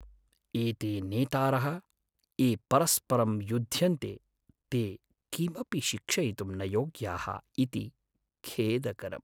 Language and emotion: Sanskrit, sad